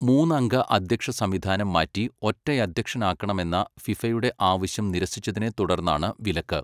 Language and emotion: Malayalam, neutral